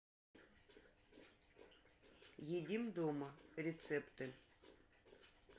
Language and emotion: Russian, neutral